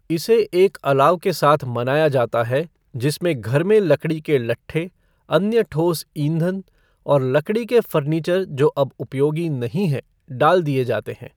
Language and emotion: Hindi, neutral